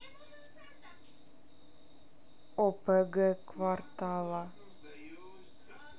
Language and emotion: Russian, neutral